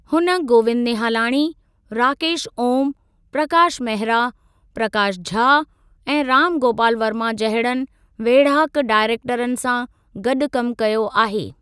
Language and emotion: Sindhi, neutral